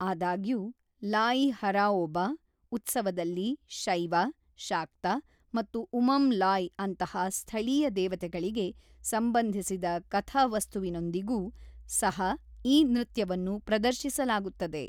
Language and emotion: Kannada, neutral